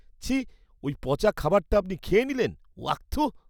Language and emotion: Bengali, disgusted